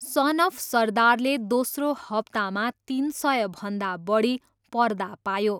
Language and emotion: Nepali, neutral